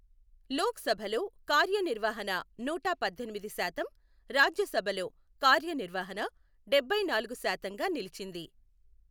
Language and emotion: Telugu, neutral